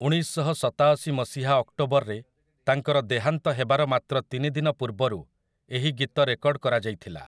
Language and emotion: Odia, neutral